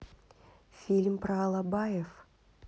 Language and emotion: Russian, neutral